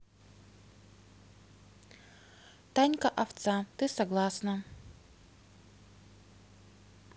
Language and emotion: Russian, neutral